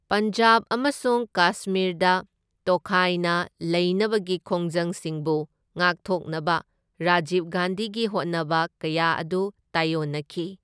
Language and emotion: Manipuri, neutral